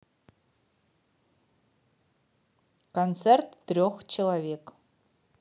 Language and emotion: Russian, neutral